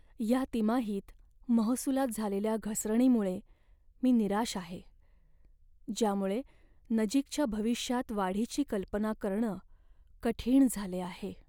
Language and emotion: Marathi, sad